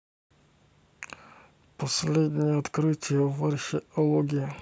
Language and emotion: Russian, neutral